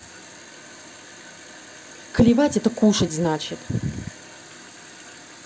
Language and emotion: Russian, angry